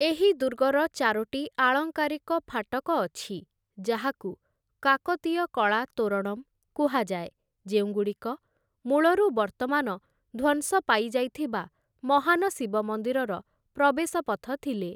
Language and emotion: Odia, neutral